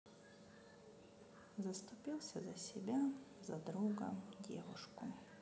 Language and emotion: Russian, sad